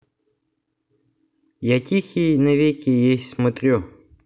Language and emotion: Russian, neutral